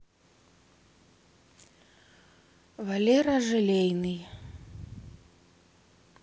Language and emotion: Russian, neutral